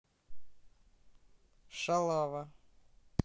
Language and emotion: Russian, neutral